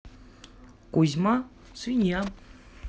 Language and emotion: Russian, neutral